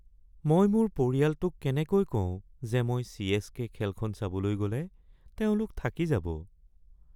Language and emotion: Assamese, sad